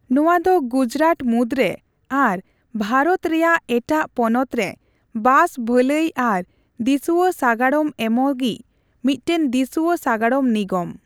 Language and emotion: Santali, neutral